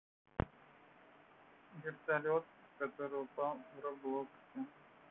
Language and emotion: Russian, neutral